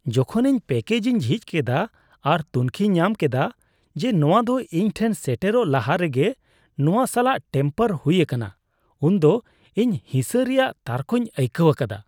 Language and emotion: Santali, disgusted